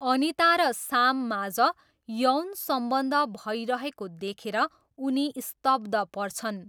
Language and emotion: Nepali, neutral